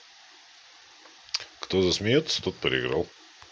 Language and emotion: Russian, positive